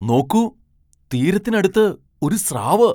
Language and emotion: Malayalam, surprised